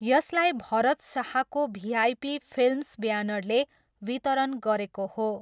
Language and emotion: Nepali, neutral